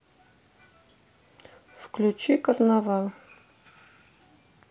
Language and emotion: Russian, neutral